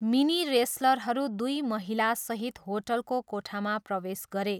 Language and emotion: Nepali, neutral